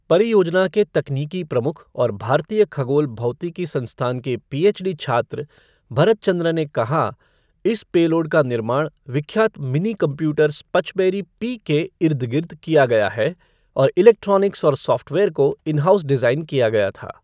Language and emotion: Hindi, neutral